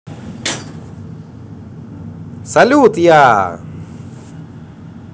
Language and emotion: Russian, positive